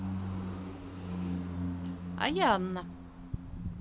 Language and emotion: Russian, neutral